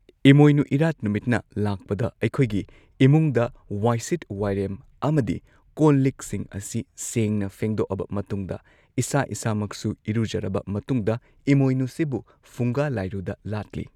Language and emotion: Manipuri, neutral